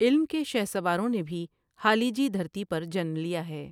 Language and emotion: Urdu, neutral